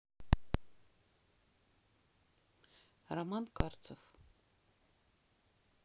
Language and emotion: Russian, neutral